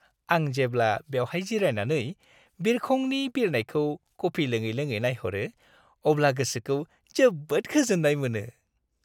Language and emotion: Bodo, happy